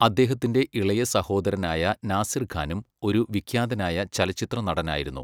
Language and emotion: Malayalam, neutral